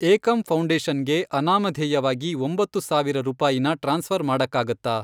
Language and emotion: Kannada, neutral